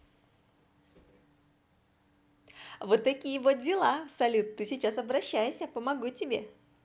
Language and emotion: Russian, positive